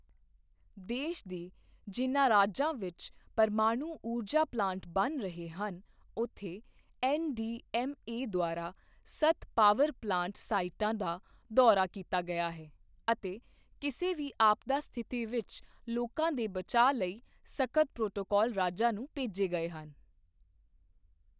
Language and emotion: Punjabi, neutral